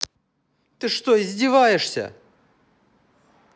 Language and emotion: Russian, angry